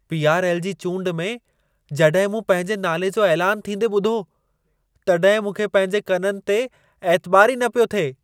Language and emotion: Sindhi, surprised